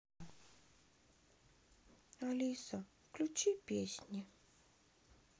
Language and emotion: Russian, sad